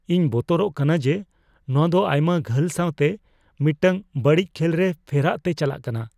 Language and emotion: Santali, fearful